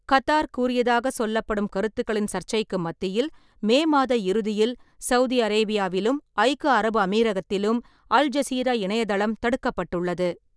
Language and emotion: Tamil, neutral